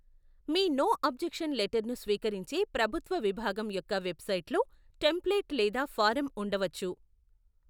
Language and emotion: Telugu, neutral